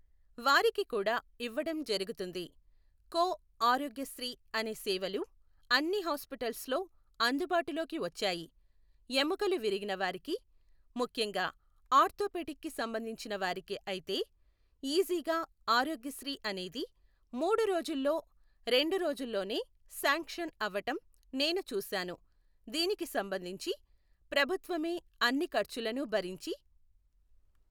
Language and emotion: Telugu, neutral